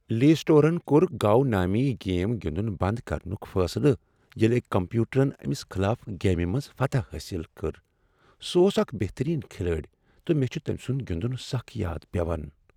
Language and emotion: Kashmiri, sad